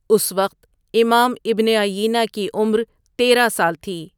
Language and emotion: Urdu, neutral